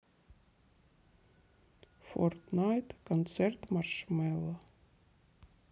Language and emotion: Russian, sad